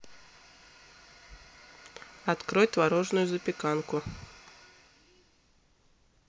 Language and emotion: Russian, neutral